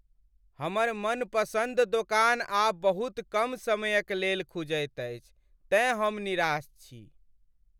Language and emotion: Maithili, sad